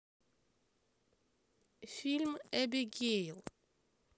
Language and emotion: Russian, neutral